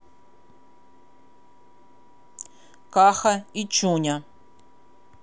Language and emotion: Russian, neutral